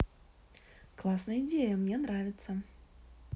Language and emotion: Russian, positive